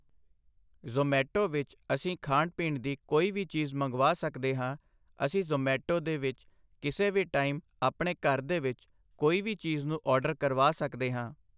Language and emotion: Punjabi, neutral